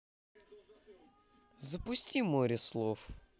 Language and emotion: Russian, positive